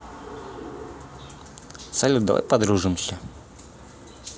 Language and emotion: Russian, positive